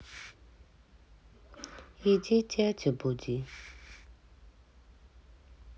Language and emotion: Russian, sad